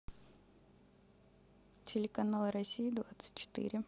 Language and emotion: Russian, neutral